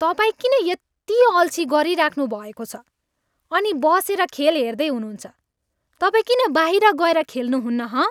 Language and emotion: Nepali, angry